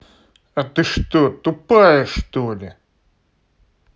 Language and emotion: Russian, angry